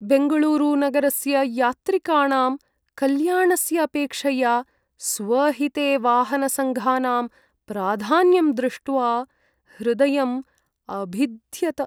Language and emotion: Sanskrit, sad